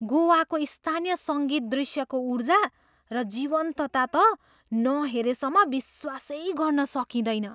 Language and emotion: Nepali, surprised